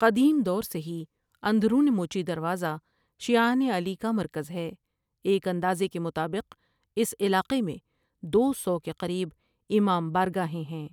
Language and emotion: Urdu, neutral